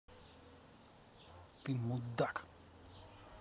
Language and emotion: Russian, angry